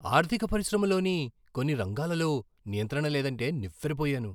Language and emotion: Telugu, surprised